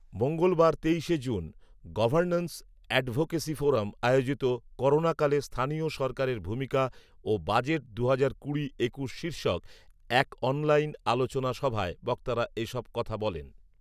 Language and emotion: Bengali, neutral